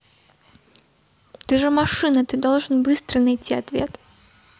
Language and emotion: Russian, neutral